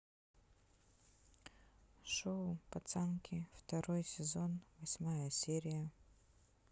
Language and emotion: Russian, neutral